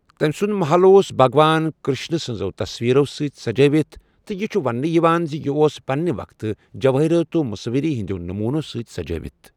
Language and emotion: Kashmiri, neutral